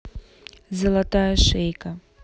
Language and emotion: Russian, neutral